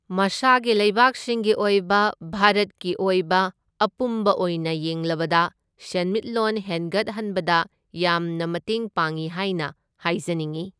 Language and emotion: Manipuri, neutral